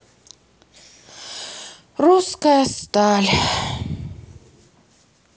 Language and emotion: Russian, sad